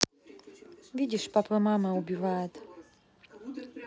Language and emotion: Russian, neutral